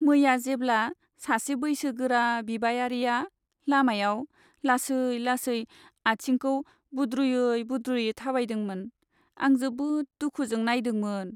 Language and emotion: Bodo, sad